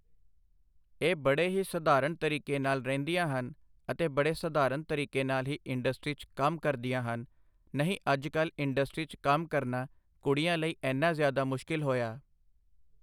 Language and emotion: Punjabi, neutral